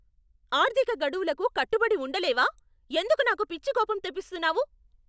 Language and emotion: Telugu, angry